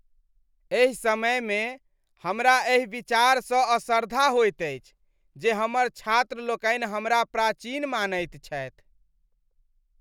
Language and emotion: Maithili, disgusted